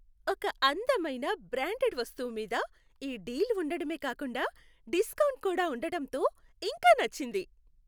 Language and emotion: Telugu, happy